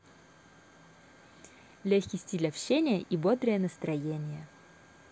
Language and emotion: Russian, positive